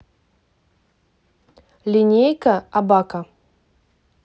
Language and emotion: Russian, neutral